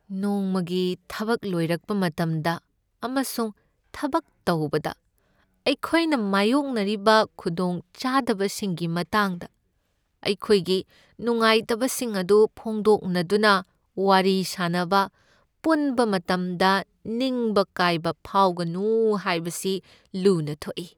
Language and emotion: Manipuri, sad